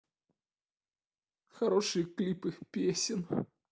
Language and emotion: Russian, sad